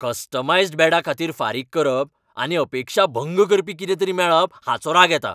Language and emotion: Goan Konkani, angry